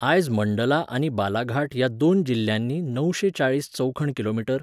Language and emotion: Goan Konkani, neutral